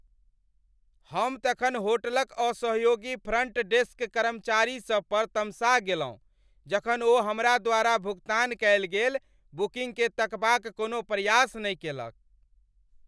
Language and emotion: Maithili, angry